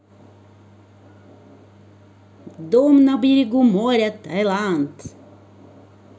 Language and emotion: Russian, positive